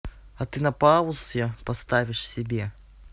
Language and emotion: Russian, neutral